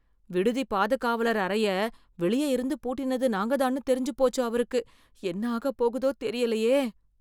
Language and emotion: Tamil, fearful